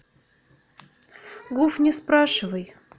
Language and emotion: Russian, neutral